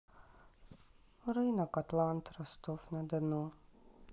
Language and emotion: Russian, sad